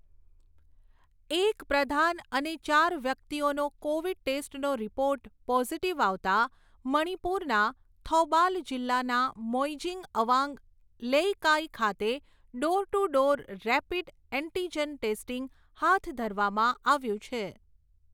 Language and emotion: Gujarati, neutral